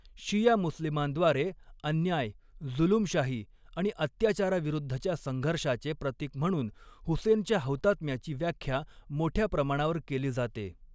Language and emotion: Marathi, neutral